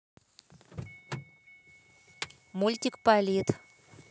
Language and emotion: Russian, neutral